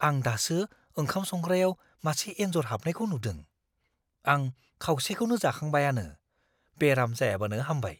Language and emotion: Bodo, fearful